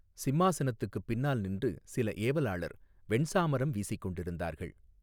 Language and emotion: Tamil, neutral